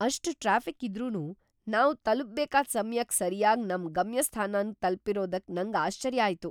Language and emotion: Kannada, surprised